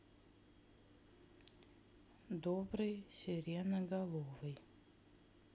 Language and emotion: Russian, neutral